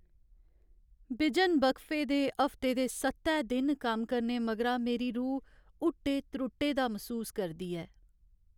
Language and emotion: Dogri, sad